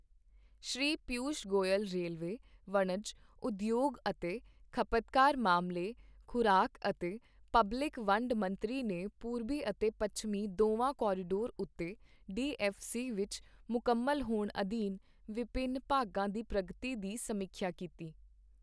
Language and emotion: Punjabi, neutral